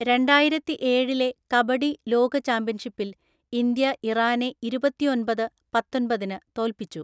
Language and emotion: Malayalam, neutral